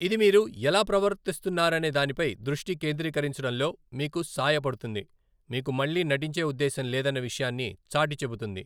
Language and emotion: Telugu, neutral